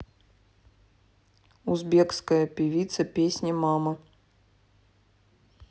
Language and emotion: Russian, neutral